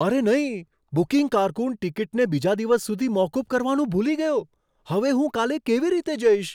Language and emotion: Gujarati, surprised